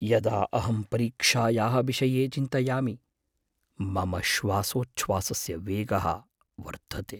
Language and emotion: Sanskrit, fearful